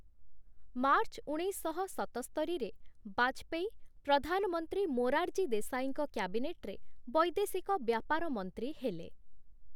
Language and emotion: Odia, neutral